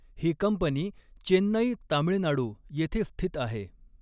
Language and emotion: Marathi, neutral